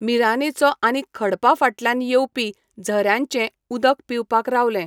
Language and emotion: Goan Konkani, neutral